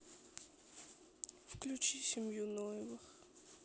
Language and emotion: Russian, sad